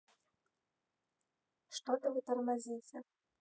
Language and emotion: Russian, neutral